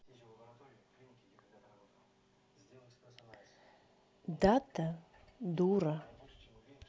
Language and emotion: Russian, neutral